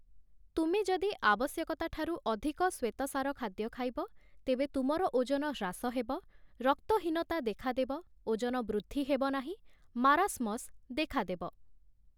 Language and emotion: Odia, neutral